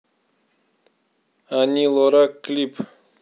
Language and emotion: Russian, neutral